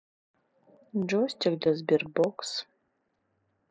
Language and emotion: Russian, neutral